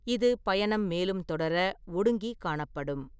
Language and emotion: Tamil, neutral